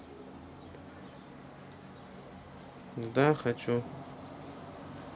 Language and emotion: Russian, neutral